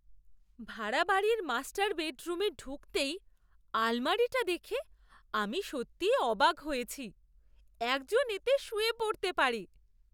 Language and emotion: Bengali, surprised